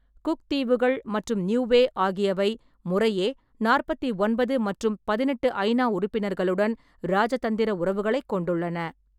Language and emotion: Tamil, neutral